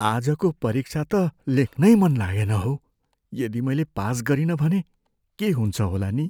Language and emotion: Nepali, fearful